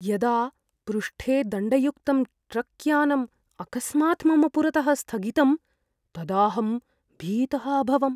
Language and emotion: Sanskrit, fearful